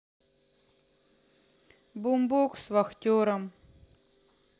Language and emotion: Russian, neutral